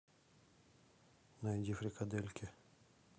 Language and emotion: Russian, neutral